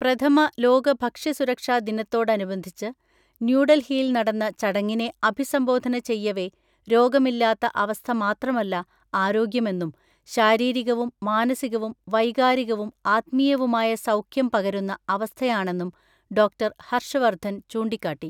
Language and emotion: Malayalam, neutral